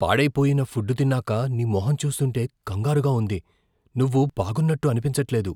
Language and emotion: Telugu, fearful